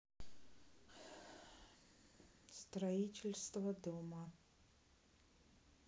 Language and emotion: Russian, neutral